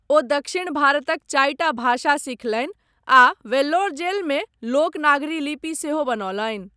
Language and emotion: Maithili, neutral